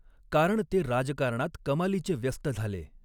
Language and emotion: Marathi, neutral